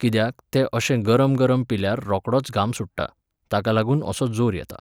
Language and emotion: Goan Konkani, neutral